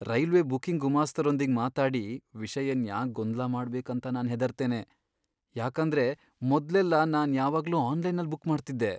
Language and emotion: Kannada, fearful